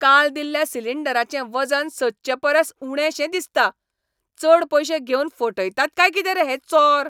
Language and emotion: Goan Konkani, angry